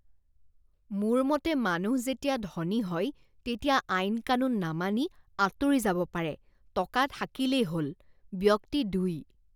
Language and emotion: Assamese, disgusted